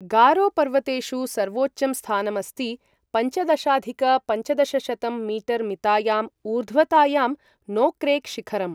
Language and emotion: Sanskrit, neutral